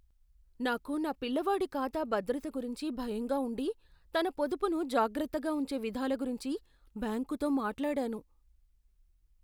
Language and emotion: Telugu, fearful